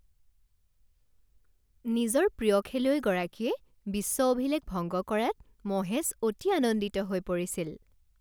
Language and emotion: Assamese, happy